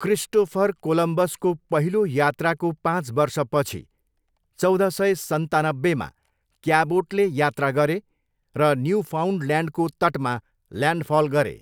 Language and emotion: Nepali, neutral